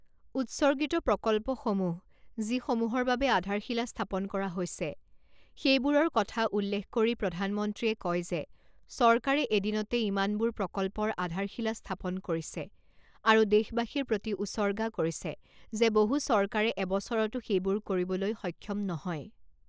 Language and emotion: Assamese, neutral